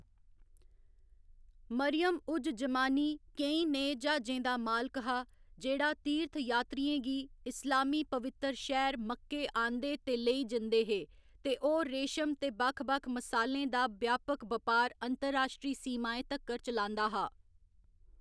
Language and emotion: Dogri, neutral